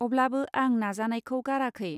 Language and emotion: Bodo, neutral